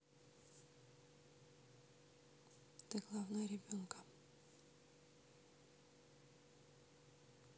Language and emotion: Russian, neutral